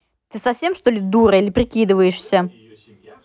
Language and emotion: Russian, angry